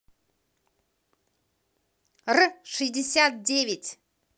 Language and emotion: Russian, positive